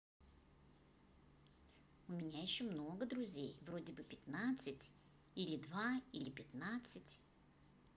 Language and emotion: Russian, positive